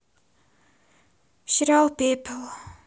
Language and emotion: Russian, sad